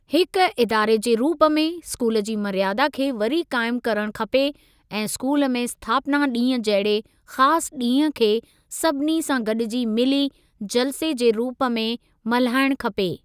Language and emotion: Sindhi, neutral